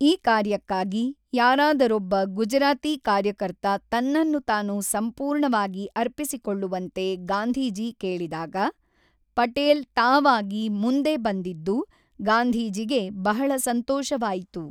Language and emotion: Kannada, neutral